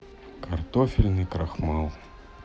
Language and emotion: Russian, sad